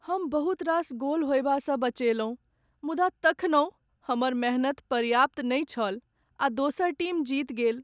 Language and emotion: Maithili, sad